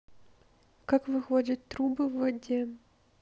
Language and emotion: Russian, neutral